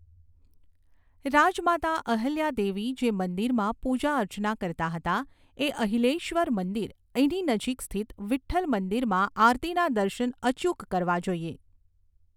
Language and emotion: Gujarati, neutral